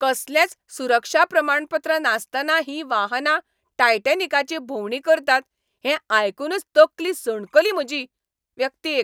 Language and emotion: Goan Konkani, angry